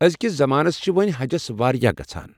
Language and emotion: Kashmiri, neutral